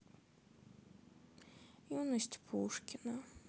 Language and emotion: Russian, sad